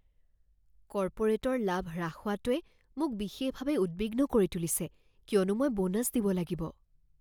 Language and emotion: Assamese, fearful